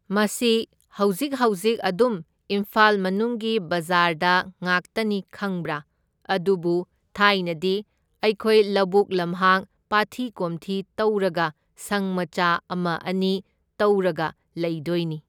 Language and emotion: Manipuri, neutral